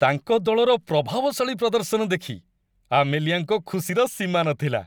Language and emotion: Odia, happy